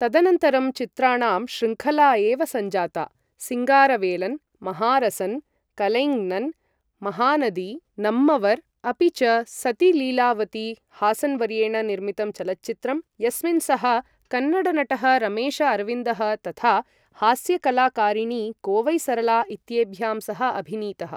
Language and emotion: Sanskrit, neutral